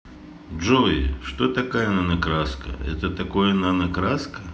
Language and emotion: Russian, neutral